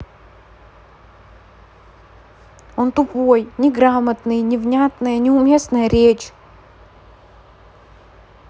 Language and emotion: Russian, angry